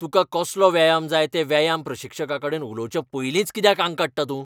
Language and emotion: Goan Konkani, angry